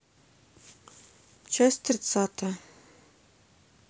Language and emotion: Russian, neutral